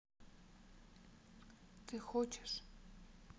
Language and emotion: Russian, sad